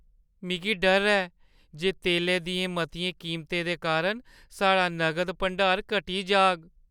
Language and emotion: Dogri, fearful